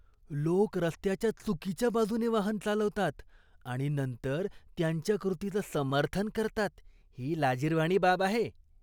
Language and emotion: Marathi, disgusted